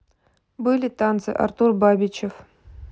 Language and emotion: Russian, neutral